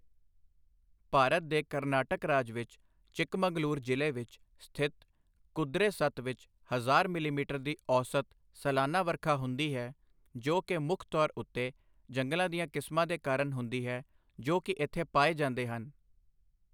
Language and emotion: Punjabi, neutral